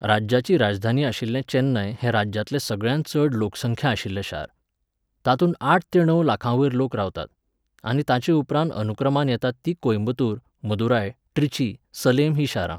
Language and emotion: Goan Konkani, neutral